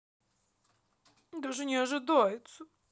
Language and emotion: Russian, sad